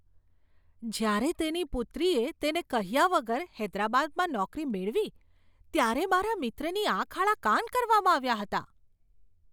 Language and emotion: Gujarati, surprised